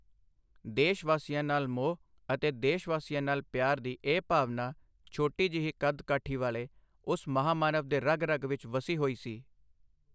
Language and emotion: Punjabi, neutral